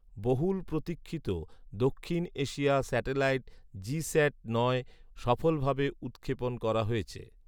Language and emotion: Bengali, neutral